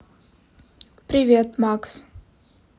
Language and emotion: Russian, neutral